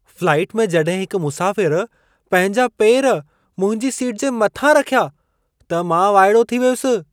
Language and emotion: Sindhi, surprised